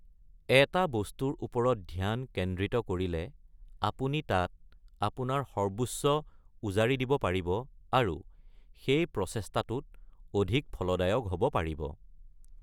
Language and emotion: Assamese, neutral